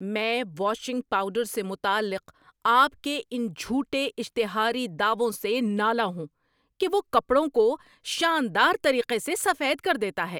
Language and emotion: Urdu, angry